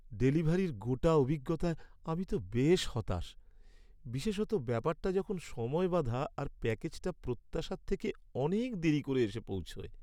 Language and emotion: Bengali, sad